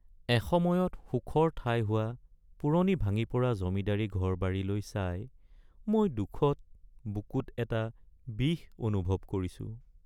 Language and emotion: Assamese, sad